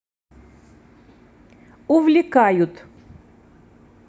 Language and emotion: Russian, neutral